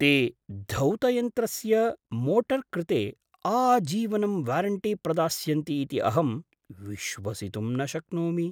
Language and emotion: Sanskrit, surprised